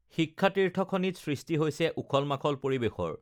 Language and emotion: Assamese, neutral